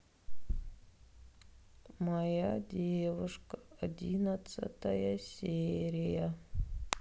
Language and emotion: Russian, sad